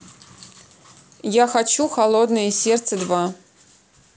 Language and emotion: Russian, neutral